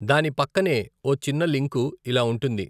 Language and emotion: Telugu, neutral